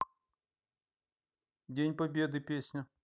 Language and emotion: Russian, neutral